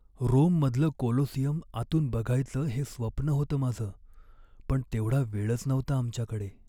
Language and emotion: Marathi, sad